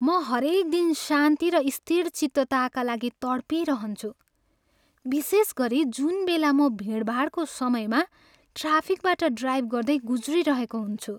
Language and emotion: Nepali, sad